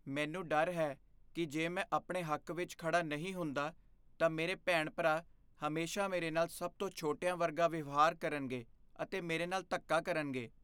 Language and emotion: Punjabi, fearful